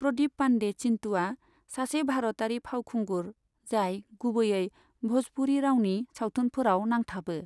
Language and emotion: Bodo, neutral